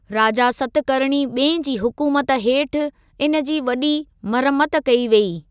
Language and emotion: Sindhi, neutral